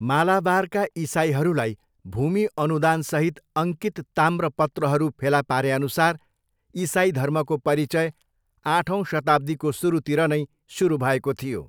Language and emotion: Nepali, neutral